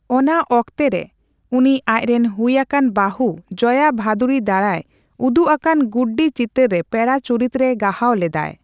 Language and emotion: Santali, neutral